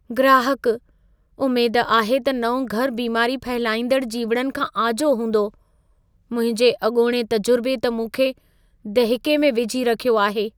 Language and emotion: Sindhi, fearful